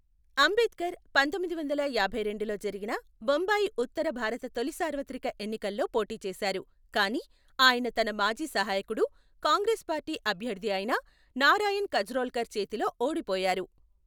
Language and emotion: Telugu, neutral